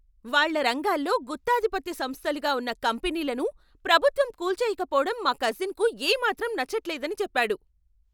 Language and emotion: Telugu, angry